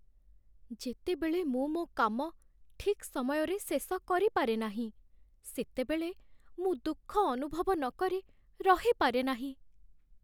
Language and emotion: Odia, sad